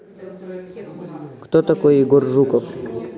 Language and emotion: Russian, neutral